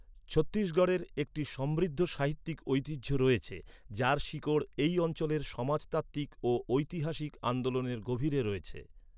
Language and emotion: Bengali, neutral